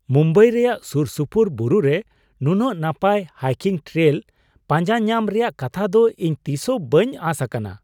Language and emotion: Santali, surprised